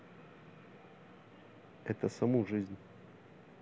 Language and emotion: Russian, neutral